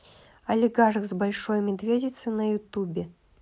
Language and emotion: Russian, neutral